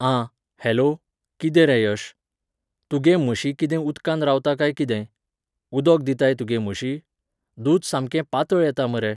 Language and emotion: Goan Konkani, neutral